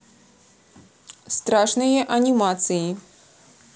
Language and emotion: Russian, neutral